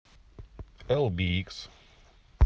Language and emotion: Russian, neutral